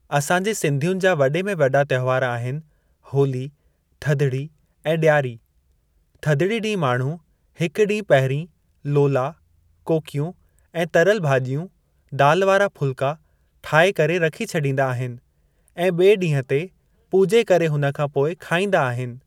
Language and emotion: Sindhi, neutral